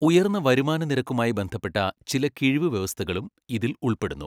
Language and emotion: Malayalam, neutral